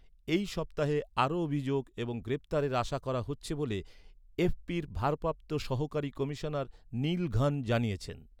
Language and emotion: Bengali, neutral